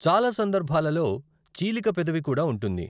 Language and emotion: Telugu, neutral